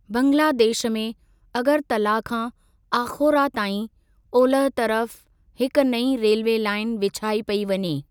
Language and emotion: Sindhi, neutral